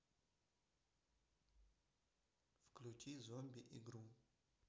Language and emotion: Russian, neutral